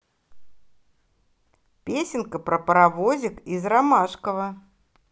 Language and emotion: Russian, positive